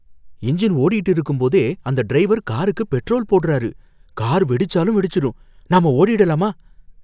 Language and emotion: Tamil, fearful